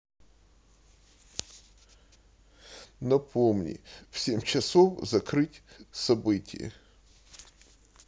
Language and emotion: Russian, sad